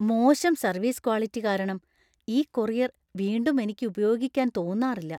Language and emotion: Malayalam, fearful